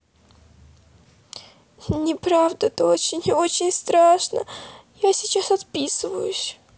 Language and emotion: Russian, sad